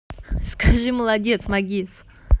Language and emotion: Russian, positive